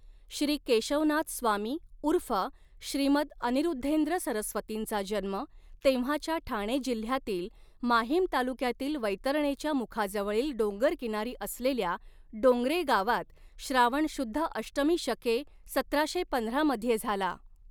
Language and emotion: Marathi, neutral